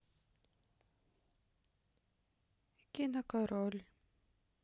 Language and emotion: Russian, sad